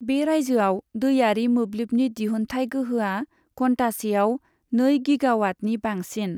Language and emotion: Bodo, neutral